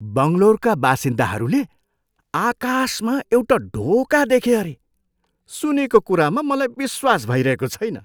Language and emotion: Nepali, surprised